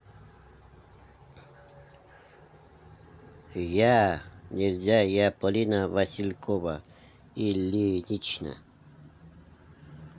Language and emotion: Russian, neutral